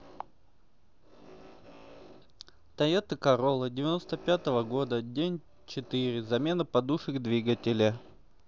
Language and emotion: Russian, neutral